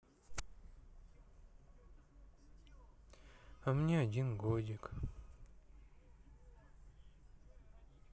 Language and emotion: Russian, sad